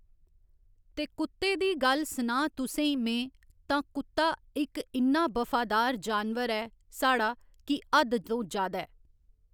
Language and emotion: Dogri, neutral